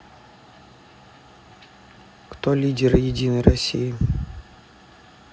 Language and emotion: Russian, neutral